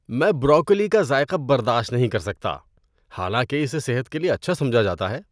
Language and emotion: Urdu, disgusted